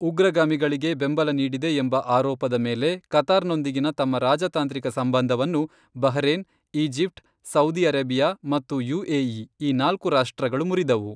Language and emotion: Kannada, neutral